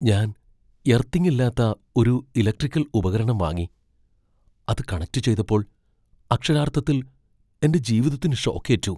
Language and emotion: Malayalam, fearful